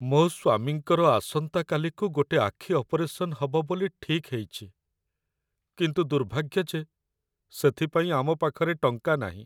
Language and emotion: Odia, sad